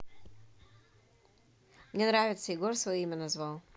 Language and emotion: Russian, neutral